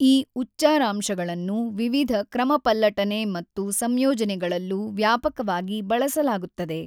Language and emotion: Kannada, neutral